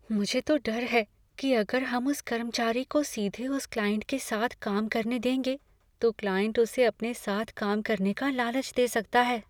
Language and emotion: Hindi, fearful